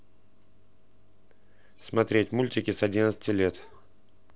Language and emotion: Russian, neutral